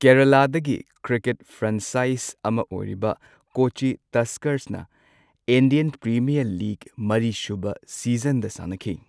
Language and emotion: Manipuri, neutral